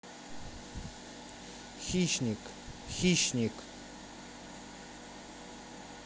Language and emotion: Russian, neutral